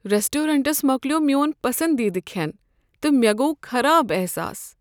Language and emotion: Kashmiri, sad